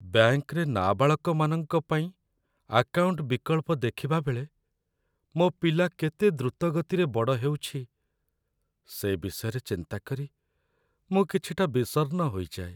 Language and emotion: Odia, sad